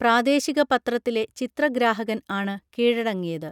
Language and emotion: Malayalam, neutral